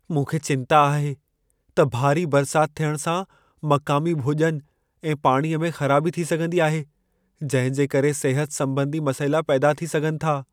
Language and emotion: Sindhi, fearful